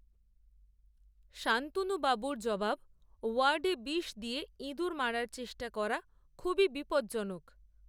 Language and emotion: Bengali, neutral